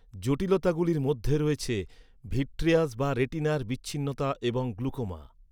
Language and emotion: Bengali, neutral